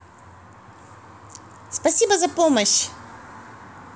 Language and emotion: Russian, positive